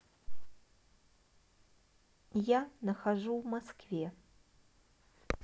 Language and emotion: Russian, neutral